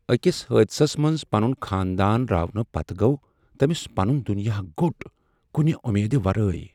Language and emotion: Kashmiri, sad